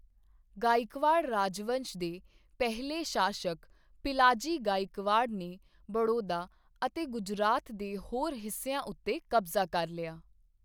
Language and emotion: Punjabi, neutral